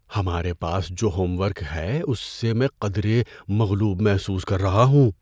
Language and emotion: Urdu, fearful